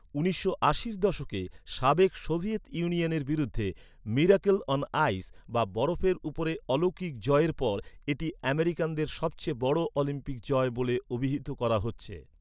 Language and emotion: Bengali, neutral